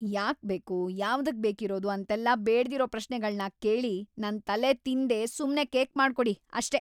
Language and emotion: Kannada, angry